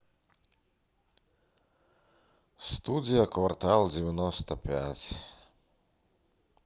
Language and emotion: Russian, sad